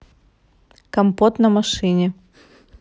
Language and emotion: Russian, positive